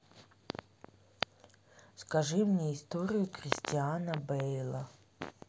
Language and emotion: Russian, neutral